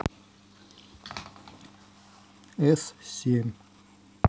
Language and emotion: Russian, neutral